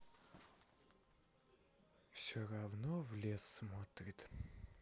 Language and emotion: Russian, sad